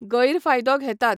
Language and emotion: Goan Konkani, neutral